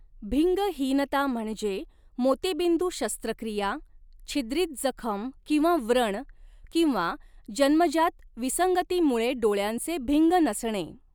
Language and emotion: Marathi, neutral